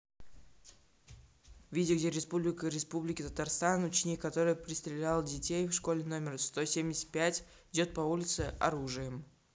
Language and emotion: Russian, neutral